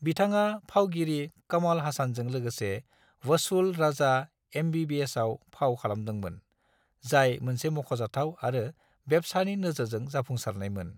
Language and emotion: Bodo, neutral